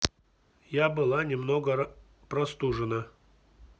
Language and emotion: Russian, neutral